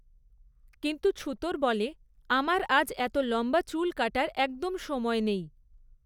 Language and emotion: Bengali, neutral